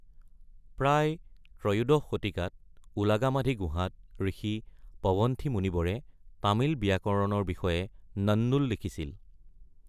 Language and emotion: Assamese, neutral